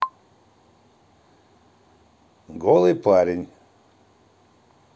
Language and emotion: Russian, neutral